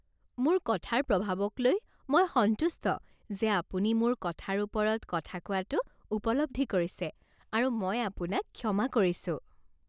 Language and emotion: Assamese, happy